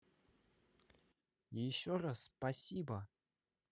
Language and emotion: Russian, positive